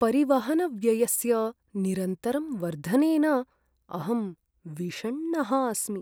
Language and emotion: Sanskrit, sad